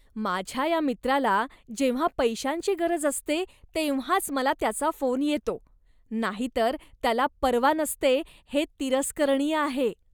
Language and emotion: Marathi, disgusted